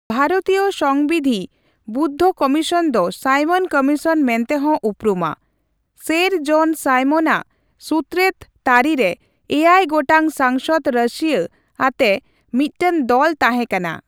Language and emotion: Santali, neutral